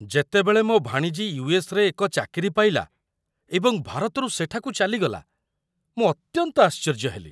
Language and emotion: Odia, surprised